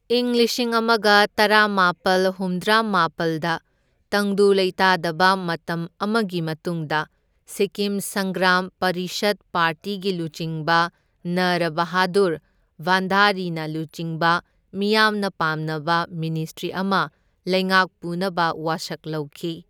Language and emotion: Manipuri, neutral